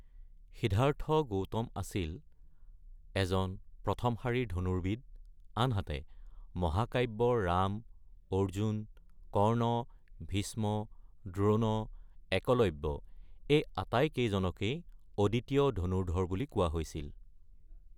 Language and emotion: Assamese, neutral